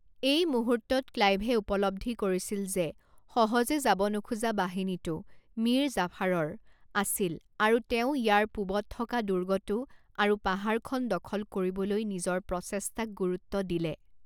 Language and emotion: Assamese, neutral